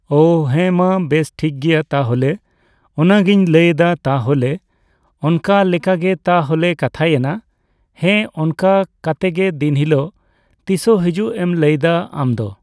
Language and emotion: Santali, neutral